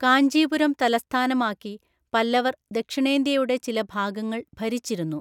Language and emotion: Malayalam, neutral